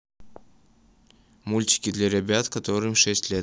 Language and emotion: Russian, neutral